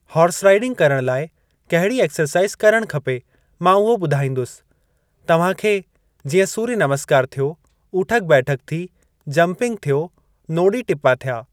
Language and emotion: Sindhi, neutral